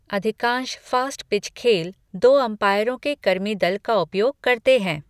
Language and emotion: Hindi, neutral